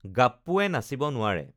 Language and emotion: Assamese, neutral